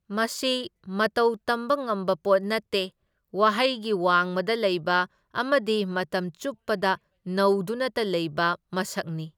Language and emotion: Manipuri, neutral